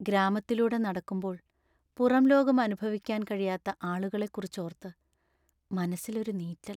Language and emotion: Malayalam, sad